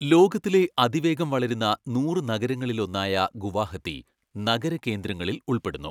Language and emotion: Malayalam, neutral